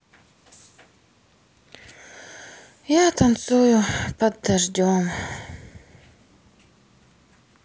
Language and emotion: Russian, sad